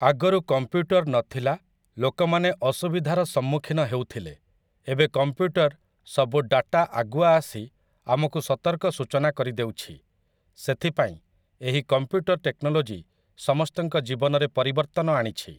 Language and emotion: Odia, neutral